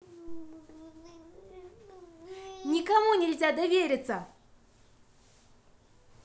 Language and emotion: Russian, angry